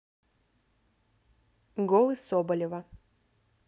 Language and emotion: Russian, neutral